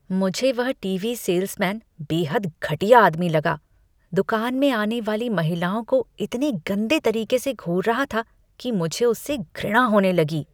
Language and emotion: Hindi, disgusted